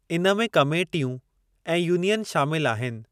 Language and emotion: Sindhi, neutral